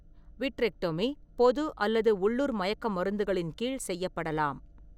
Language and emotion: Tamil, neutral